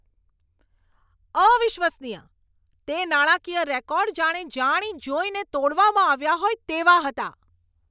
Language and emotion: Gujarati, angry